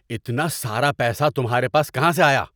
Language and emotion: Urdu, angry